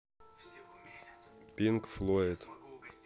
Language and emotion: Russian, neutral